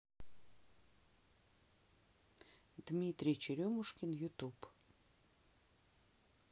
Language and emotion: Russian, neutral